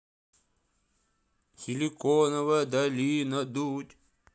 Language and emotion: Russian, positive